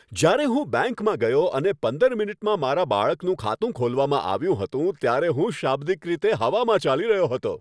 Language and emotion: Gujarati, happy